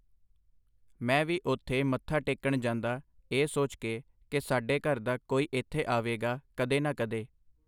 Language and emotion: Punjabi, neutral